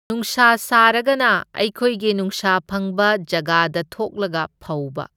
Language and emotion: Manipuri, neutral